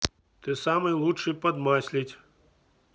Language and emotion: Russian, neutral